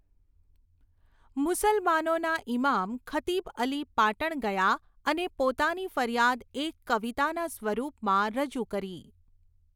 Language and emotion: Gujarati, neutral